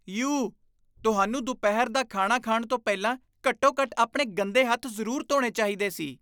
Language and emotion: Punjabi, disgusted